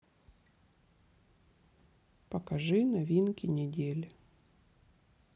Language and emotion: Russian, sad